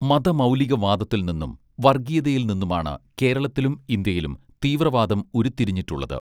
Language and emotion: Malayalam, neutral